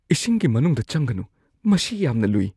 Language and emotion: Manipuri, fearful